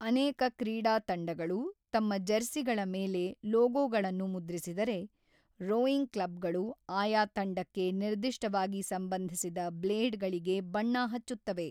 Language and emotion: Kannada, neutral